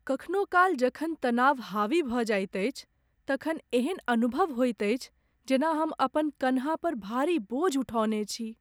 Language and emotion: Maithili, sad